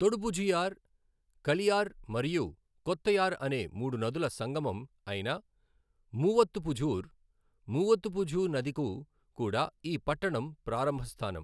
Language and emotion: Telugu, neutral